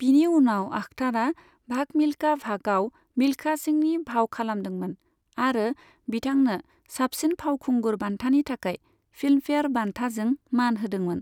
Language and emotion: Bodo, neutral